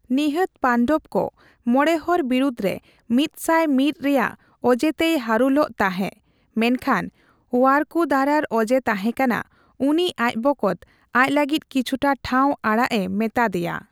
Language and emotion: Santali, neutral